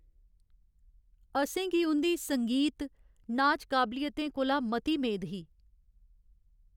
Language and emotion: Dogri, sad